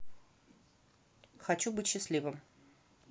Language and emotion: Russian, neutral